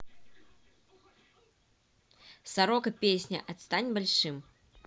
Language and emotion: Russian, neutral